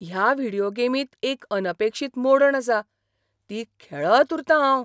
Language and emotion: Goan Konkani, surprised